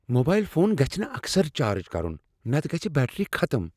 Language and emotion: Kashmiri, fearful